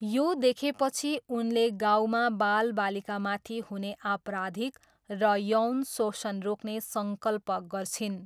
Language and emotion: Nepali, neutral